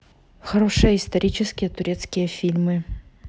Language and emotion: Russian, neutral